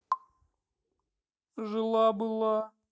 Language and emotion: Russian, sad